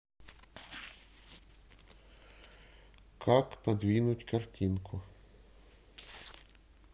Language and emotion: Russian, neutral